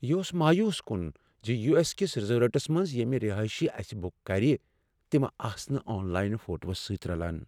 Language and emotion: Kashmiri, sad